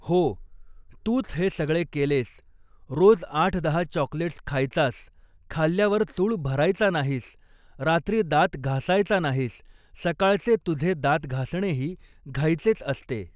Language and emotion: Marathi, neutral